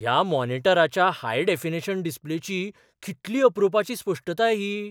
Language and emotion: Goan Konkani, surprised